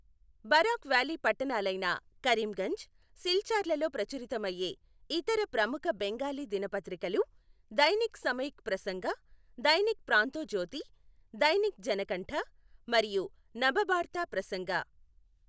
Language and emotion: Telugu, neutral